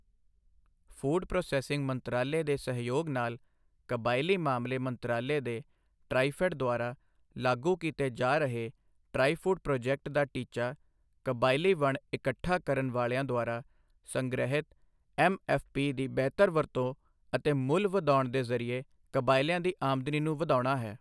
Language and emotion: Punjabi, neutral